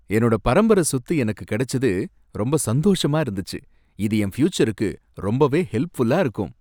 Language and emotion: Tamil, happy